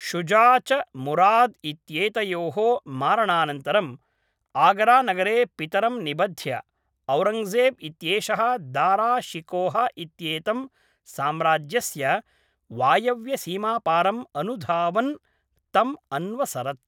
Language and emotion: Sanskrit, neutral